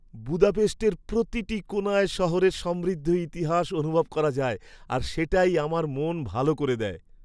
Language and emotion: Bengali, happy